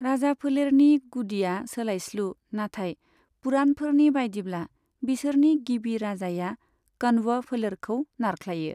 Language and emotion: Bodo, neutral